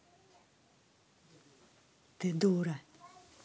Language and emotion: Russian, angry